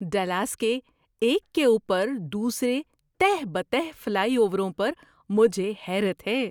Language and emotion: Urdu, surprised